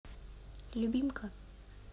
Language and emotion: Russian, neutral